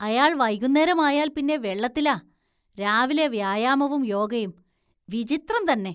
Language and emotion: Malayalam, disgusted